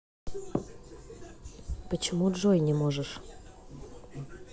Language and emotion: Russian, neutral